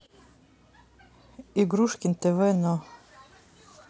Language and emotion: Russian, neutral